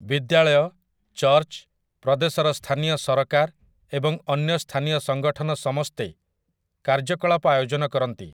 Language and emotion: Odia, neutral